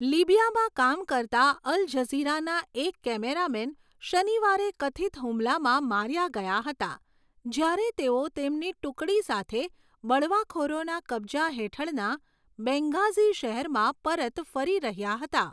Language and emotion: Gujarati, neutral